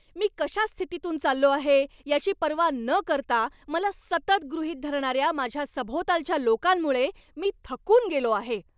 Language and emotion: Marathi, angry